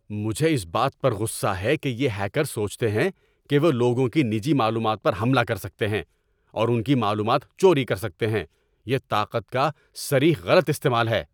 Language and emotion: Urdu, angry